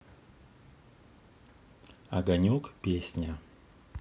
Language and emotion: Russian, neutral